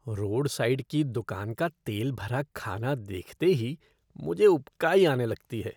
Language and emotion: Hindi, disgusted